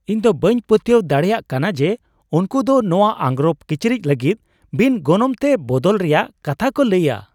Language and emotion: Santali, surprised